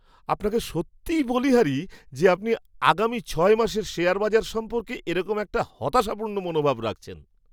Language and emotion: Bengali, surprised